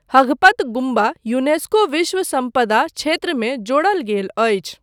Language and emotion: Maithili, neutral